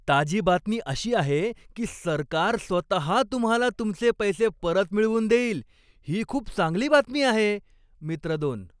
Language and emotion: Marathi, happy